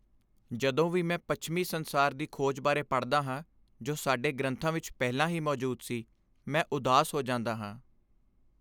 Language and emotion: Punjabi, sad